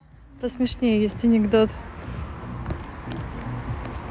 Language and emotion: Russian, neutral